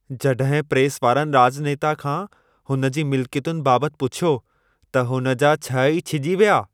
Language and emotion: Sindhi, angry